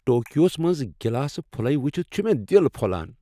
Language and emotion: Kashmiri, happy